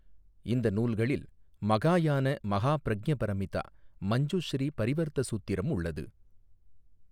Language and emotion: Tamil, neutral